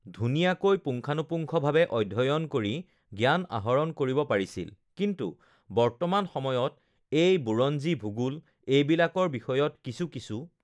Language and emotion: Assamese, neutral